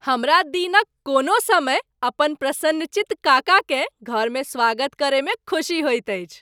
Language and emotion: Maithili, happy